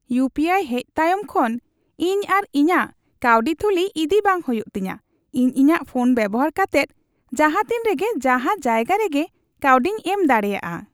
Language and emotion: Santali, happy